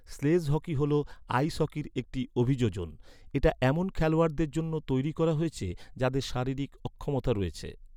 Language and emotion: Bengali, neutral